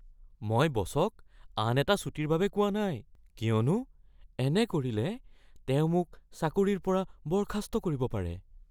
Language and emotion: Assamese, fearful